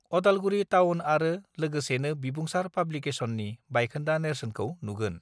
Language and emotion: Bodo, neutral